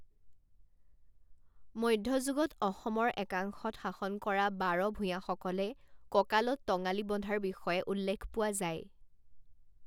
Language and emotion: Assamese, neutral